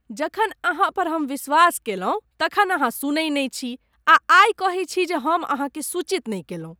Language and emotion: Maithili, disgusted